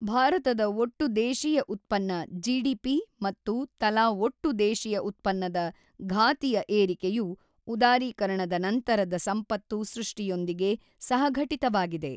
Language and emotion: Kannada, neutral